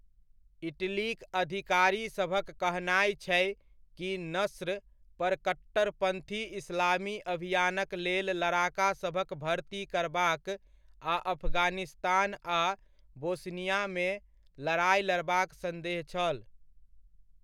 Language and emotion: Maithili, neutral